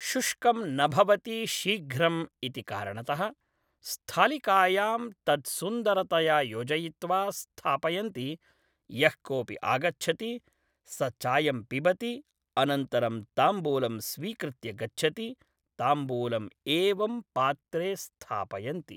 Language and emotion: Sanskrit, neutral